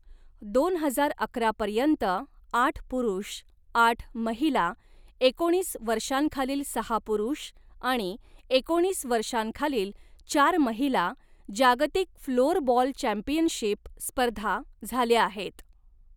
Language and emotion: Marathi, neutral